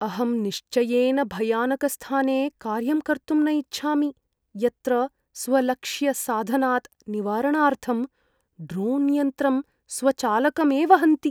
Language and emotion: Sanskrit, fearful